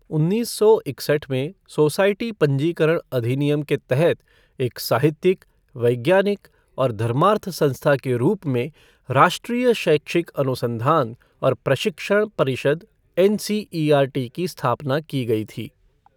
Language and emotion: Hindi, neutral